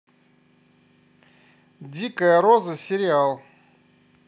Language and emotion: Russian, neutral